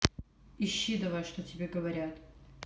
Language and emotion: Russian, angry